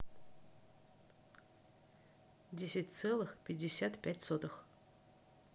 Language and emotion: Russian, neutral